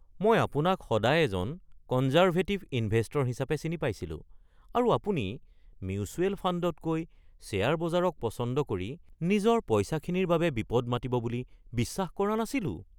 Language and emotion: Assamese, surprised